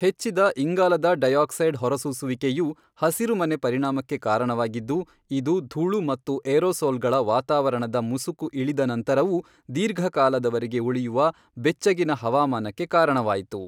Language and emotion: Kannada, neutral